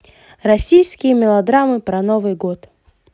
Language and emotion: Russian, positive